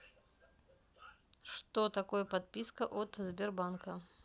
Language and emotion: Russian, neutral